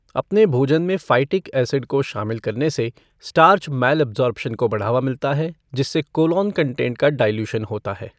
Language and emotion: Hindi, neutral